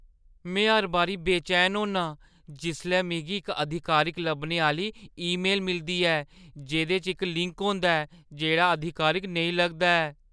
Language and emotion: Dogri, fearful